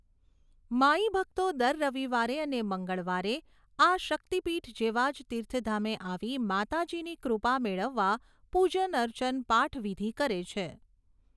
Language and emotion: Gujarati, neutral